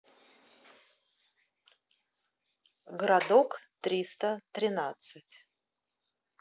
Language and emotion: Russian, neutral